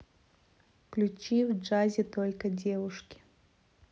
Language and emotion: Russian, neutral